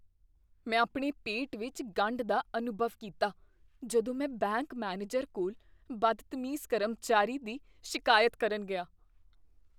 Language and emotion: Punjabi, fearful